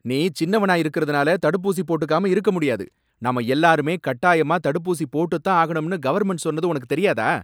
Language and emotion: Tamil, angry